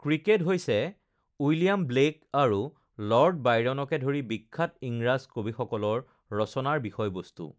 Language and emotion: Assamese, neutral